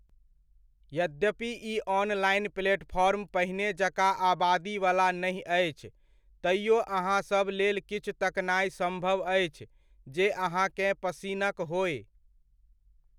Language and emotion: Maithili, neutral